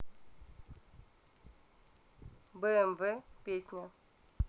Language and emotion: Russian, neutral